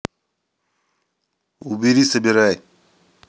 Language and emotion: Russian, angry